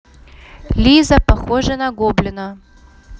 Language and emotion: Russian, neutral